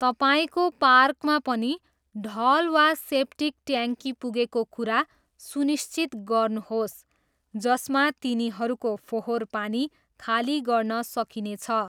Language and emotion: Nepali, neutral